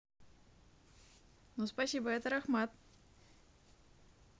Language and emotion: Russian, positive